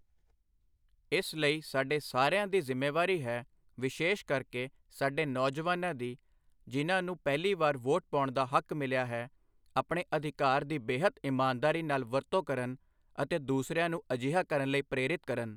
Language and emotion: Punjabi, neutral